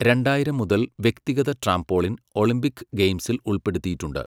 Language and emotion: Malayalam, neutral